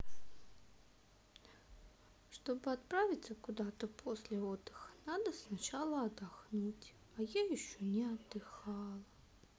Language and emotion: Russian, sad